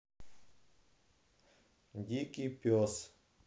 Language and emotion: Russian, neutral